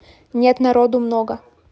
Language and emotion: Russian, neutral